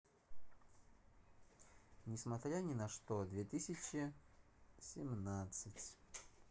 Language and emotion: Russian, neutral